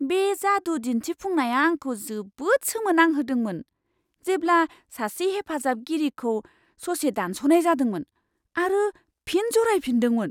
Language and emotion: Bodo, surprised